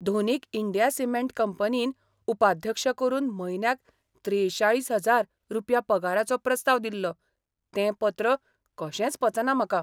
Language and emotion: Goan Konkani, surprised